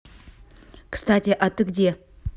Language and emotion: Russian, neutral